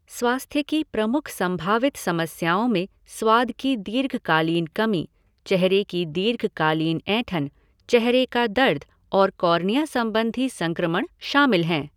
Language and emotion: Hindi, neutral